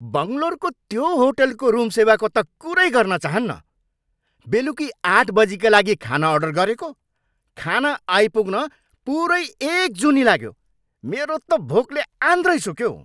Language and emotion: Nepali, angry